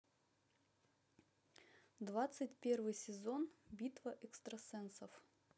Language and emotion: Russian, neutral